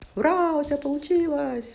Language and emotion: Russian, positive